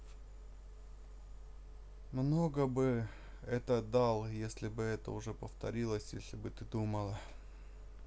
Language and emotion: Russian, sad